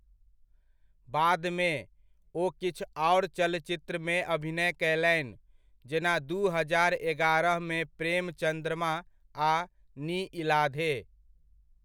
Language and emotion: Maithili, neutral